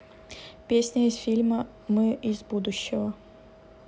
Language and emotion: Russian, neutral